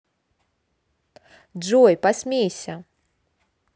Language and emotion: Russian, positive